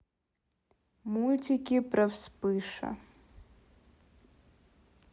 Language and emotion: Russian, neutral